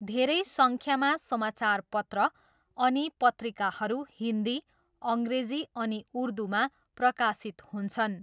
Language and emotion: Nepali, neutral